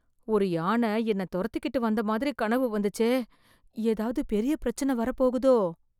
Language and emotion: Tamil, fearful